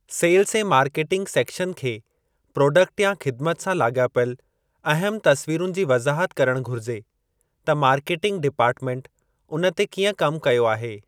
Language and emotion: Sindhi, neutral